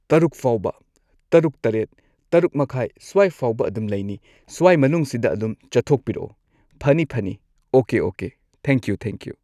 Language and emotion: Manipuri, neutral